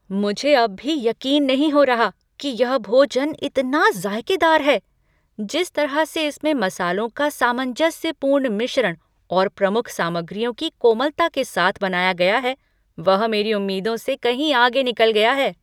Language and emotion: Hindi, surprised